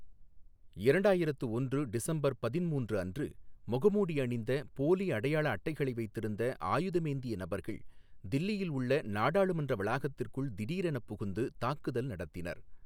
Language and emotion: Tamil, neutral